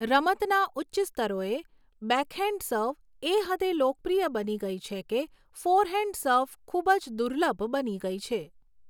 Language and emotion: Gujarati, neutral